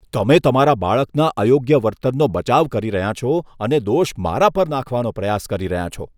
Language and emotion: Gujarati, disgusted